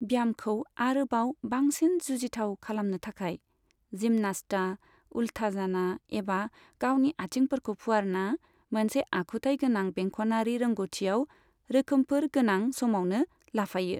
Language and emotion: Bodo, neutral